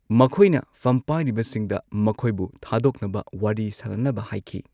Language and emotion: Manipuri, neutral